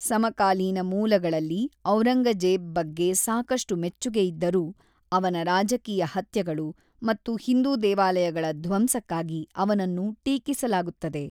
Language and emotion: Kannada, neutral